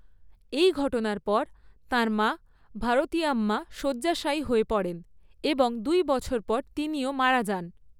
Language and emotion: Bengali, neutral